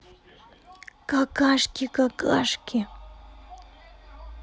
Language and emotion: Russian, neutral